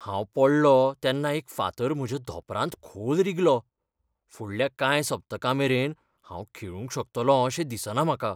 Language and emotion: Goan Konkani, fearful